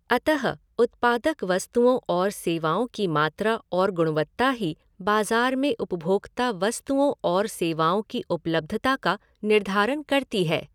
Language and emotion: Hindi, neutral